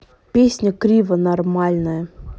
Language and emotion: Russian, neutral